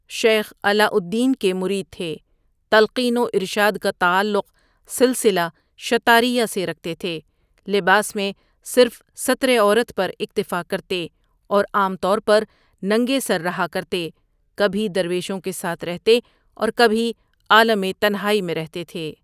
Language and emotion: Urdu, neutral